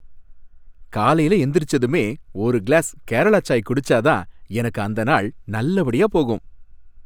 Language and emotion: Tamil, happy